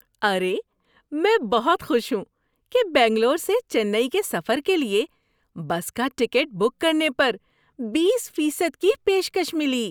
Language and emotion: Urdu, happy